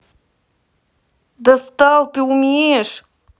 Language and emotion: Russian, angry